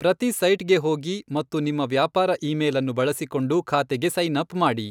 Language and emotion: Kannada, neutral